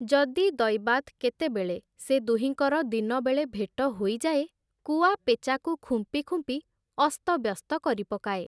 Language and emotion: Odia, neutral